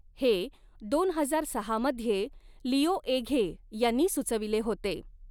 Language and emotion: Marathi, neutral